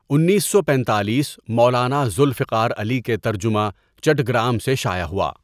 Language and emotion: Urdu, neutral